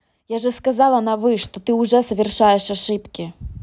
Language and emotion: Russian, angry